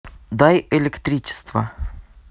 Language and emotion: Russian, neutral